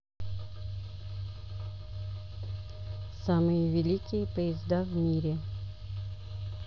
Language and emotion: Russian, neutral